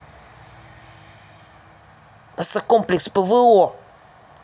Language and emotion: Russian, angry